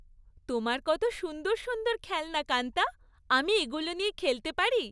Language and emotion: Bengali, happy